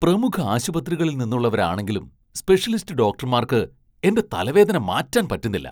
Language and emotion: Malayalam, surprised